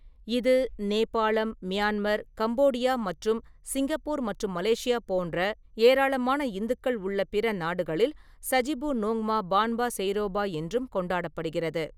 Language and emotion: Tamil, neutral